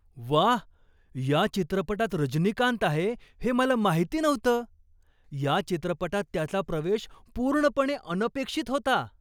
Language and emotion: Marathi, surprised